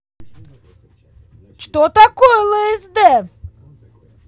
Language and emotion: Russian, angry